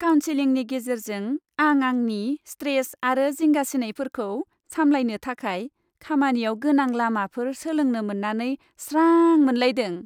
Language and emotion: Bodo, happy